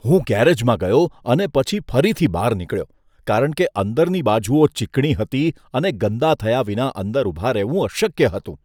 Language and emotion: Gujarati, disgusted